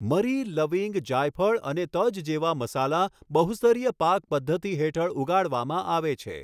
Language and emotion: Gujarati, neutral